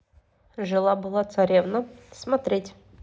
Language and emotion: Russian, neutral